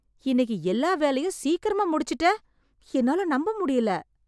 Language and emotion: Tamil, surprised